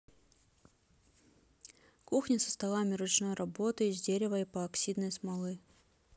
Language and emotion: Russian, neutral